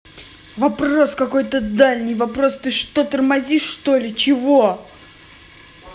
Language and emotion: Russian, angry